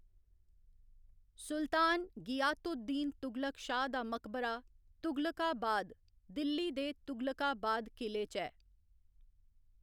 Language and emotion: Dogri, neutral